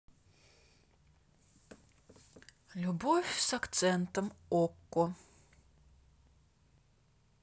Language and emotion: Russian, neutral